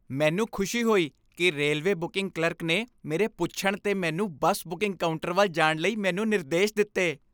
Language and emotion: Punjabi, happy